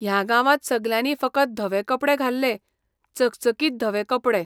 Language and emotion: Goan Konkani, neutral